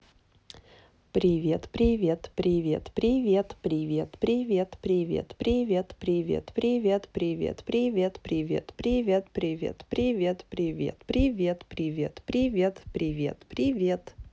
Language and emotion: Russian, positive